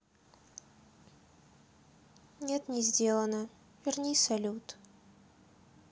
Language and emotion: Russian, sad